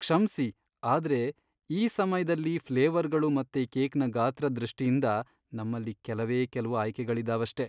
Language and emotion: Kannada, sad